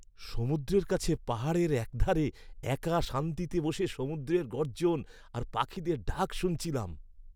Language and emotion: Bengali, happy